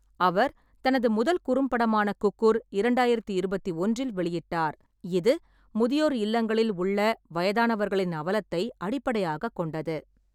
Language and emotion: Tamil, neutral